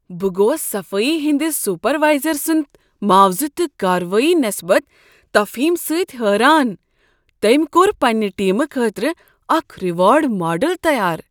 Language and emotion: Kashmiri, surprised